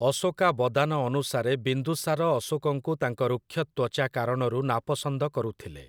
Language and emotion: Odia, neutral